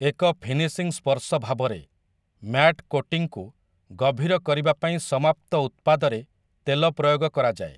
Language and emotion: Odia, neutral